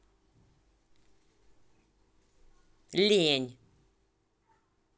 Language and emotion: Russian, angry